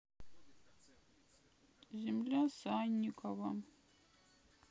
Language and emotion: Russian, sad